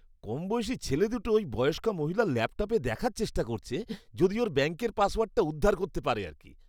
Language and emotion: Bengali, disgusted